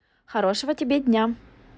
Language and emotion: Russian, positive